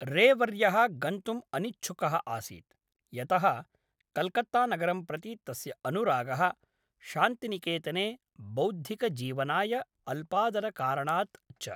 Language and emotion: Sanskrit, neutral